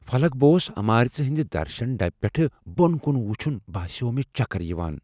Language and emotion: Kashmiri, fearful